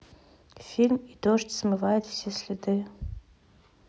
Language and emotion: Russian, neutral